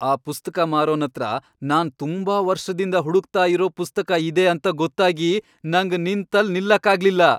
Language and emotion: Kannada, happy